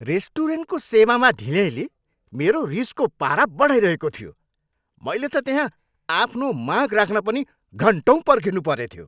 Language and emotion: Nepali, angry